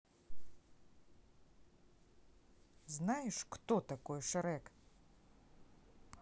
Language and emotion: Russian, neutral